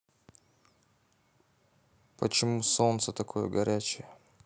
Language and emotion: Russian, neutral